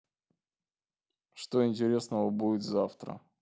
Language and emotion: Russian, neutral